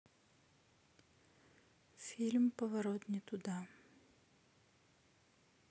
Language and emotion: Russian, neutral